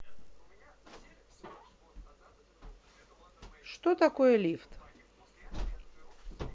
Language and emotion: Russian, neutral